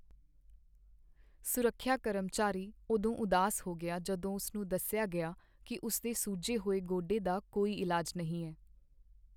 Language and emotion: Punjabi, sad